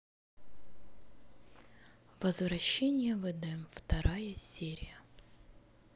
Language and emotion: Russian, neutral